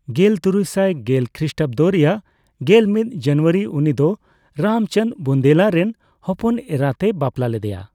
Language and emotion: Santali, neutral